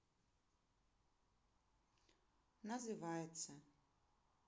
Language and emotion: Russian, sad